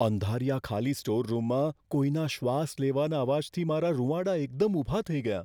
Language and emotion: Gujarati, fearful